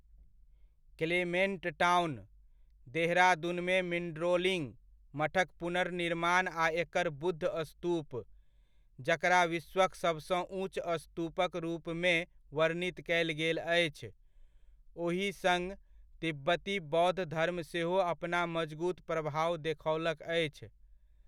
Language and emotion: Maithili, neutral